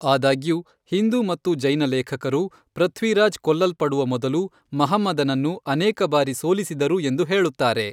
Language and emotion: Kannada, neutral